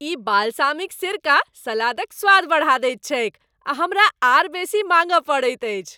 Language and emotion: Maithili, happy